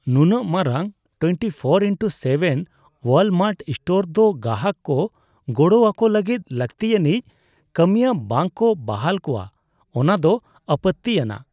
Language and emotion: Santali, disgusted